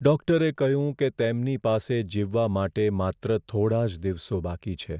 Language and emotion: Gujarati, sad